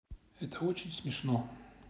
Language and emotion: Russian, neutral